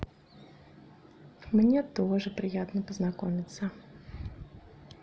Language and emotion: Russian, positive